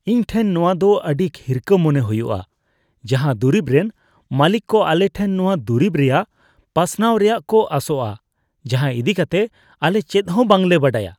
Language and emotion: Santali, disgusted